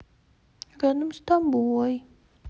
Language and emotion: Russian, sad